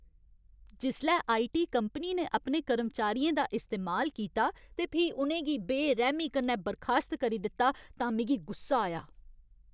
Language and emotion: Dogri, angry